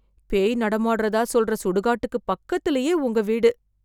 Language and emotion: Tamil, fearful